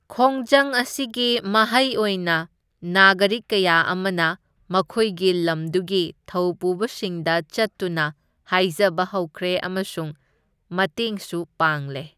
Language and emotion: Manipuri, neutral